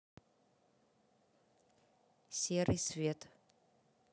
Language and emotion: Russian, neutral